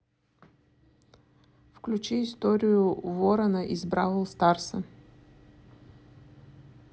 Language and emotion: Russian, neutral